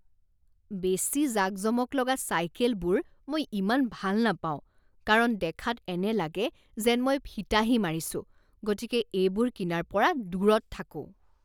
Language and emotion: Assamese, disgusted